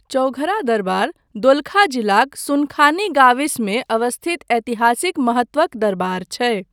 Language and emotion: Maithili, neutral